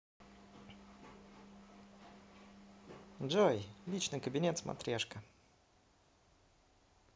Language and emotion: Russian, positive